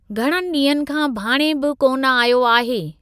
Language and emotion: Sindhi, neutral